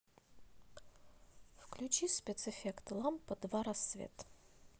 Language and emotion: Russian, neutral